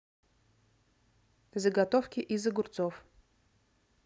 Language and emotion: Russian, neutral